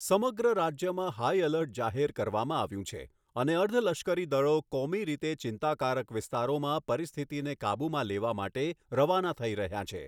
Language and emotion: Gujarati, neutral